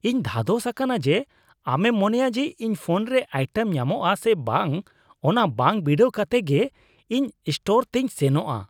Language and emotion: Santali, disgusted